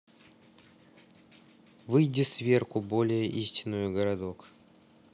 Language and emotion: Russian, neutral